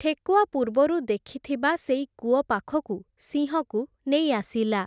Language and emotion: Odia, neutral